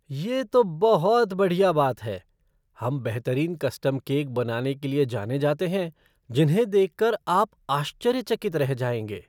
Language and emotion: Hindi, surprised